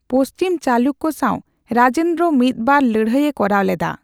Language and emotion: Santali, neutral